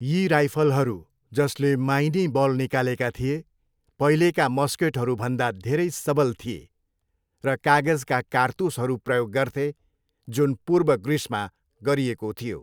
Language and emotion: Nepali, neutral